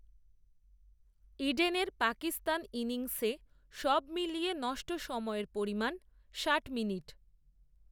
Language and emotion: Bengali, neutral